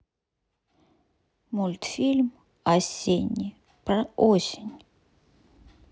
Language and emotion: Russian, neutral